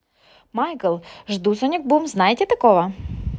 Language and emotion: Russian, positive